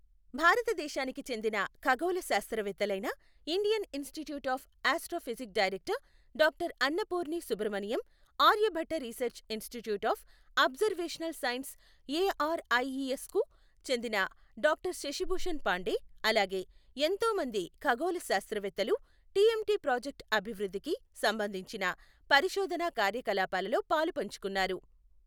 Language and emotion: Telugu, neutral